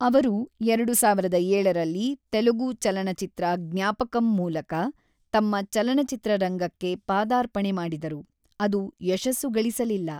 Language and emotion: Kannada, neutral